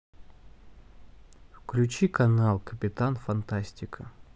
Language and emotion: Russian, neutral